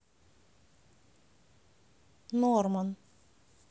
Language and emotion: Russian, neutral